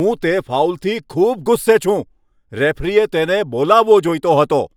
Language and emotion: Gujarati, angry